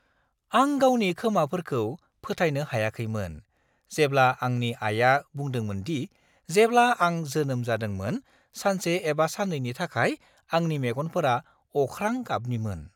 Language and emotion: Bodo, surprised